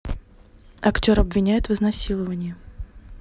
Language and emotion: Russian, neutral